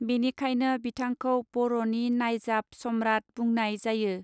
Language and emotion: Bodo, neutral